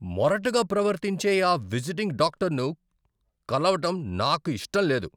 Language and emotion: Telugu, angry